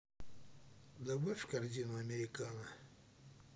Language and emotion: Russian, neutral